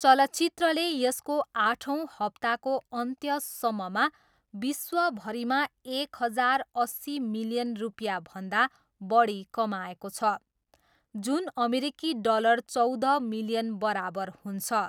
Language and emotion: Nepali, neutral